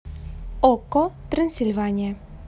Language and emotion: Russian, neutral